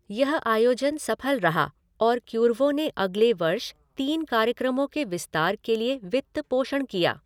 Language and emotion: Hindi, neutral